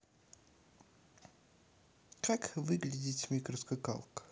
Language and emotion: Russian, neutral